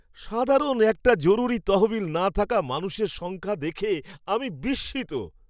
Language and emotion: Bengali, surprised